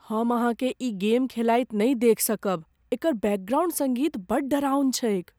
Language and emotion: Maithili, fearful